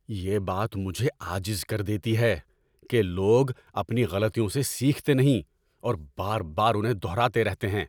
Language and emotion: Urdu, angry